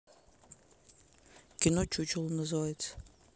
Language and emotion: Russian, neutral